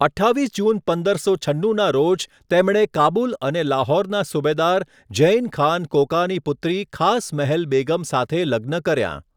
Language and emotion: Gujarati, neutral